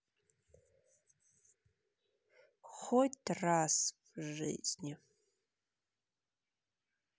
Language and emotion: Russian, sad